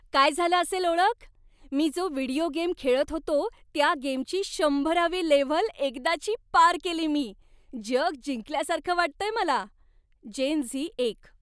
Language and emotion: Marathi, happy